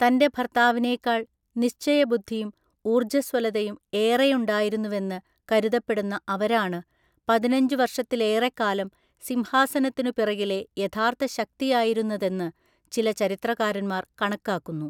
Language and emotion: Malayalam, neutral